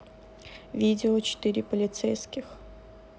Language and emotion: Russian, neutral